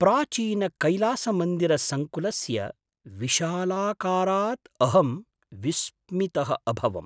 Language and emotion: Sanskrit, surprised